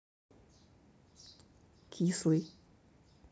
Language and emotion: Russian, neutral